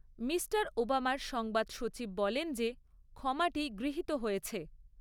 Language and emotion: Bengali, neutral